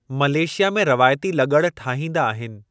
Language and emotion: Sindhi, neutral